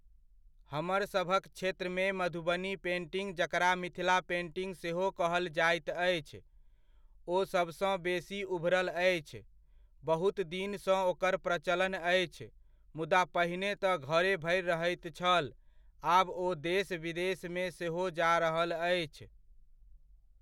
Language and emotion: Maithili, neutral